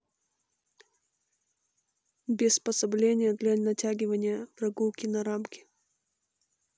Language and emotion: Russian, neutral